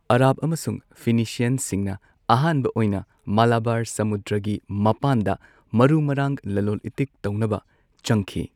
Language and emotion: Manipuri, neutral